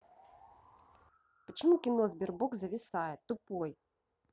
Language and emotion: Russian, angry